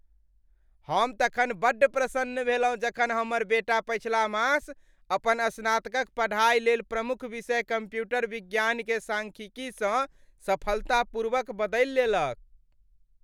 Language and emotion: Maithili, happy